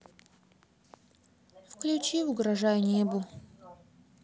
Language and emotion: Russian, sad